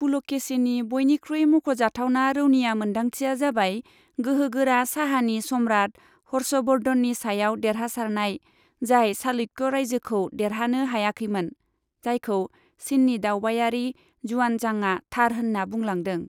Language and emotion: Bodo, neutral